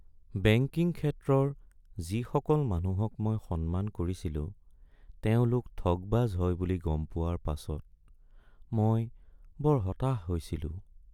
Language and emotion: Assamese, sad